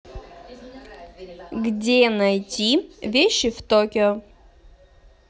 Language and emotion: Russian, neutral